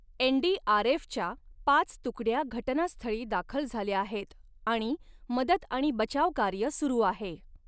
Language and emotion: Marathi, neutral